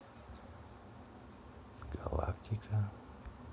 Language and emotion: Russian, neutral